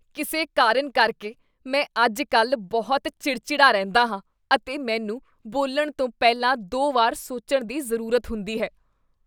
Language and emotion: Punjabi, disgusted